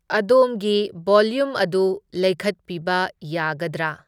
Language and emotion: Manipuri, neutral